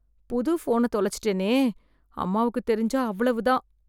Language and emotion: Tamil, fearful